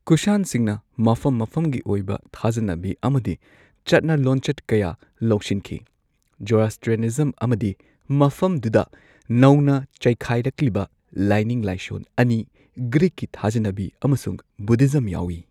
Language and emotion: Manipuri, neutral